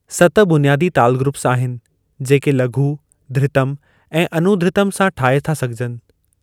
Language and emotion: Sindhi, neutral